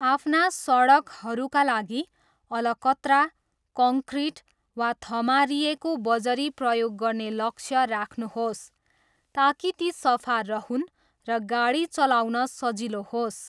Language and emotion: Nepali, neutral